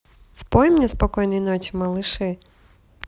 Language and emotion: Russian, neutral